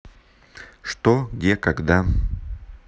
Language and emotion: Russian, neutral